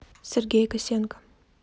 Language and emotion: Russian, neutral